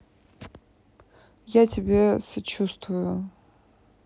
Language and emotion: Russian, sad